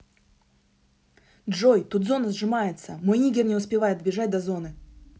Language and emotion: Russian, angry